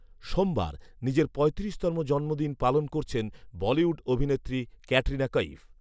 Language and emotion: Bengali, neutral